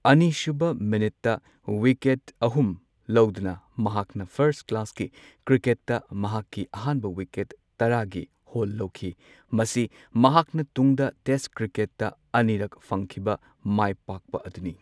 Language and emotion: Manipuri, neutral